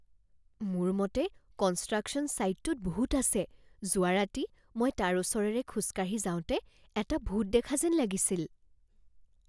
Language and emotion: Assamese, fearful